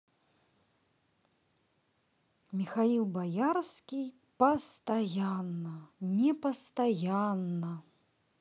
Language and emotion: Russian, positive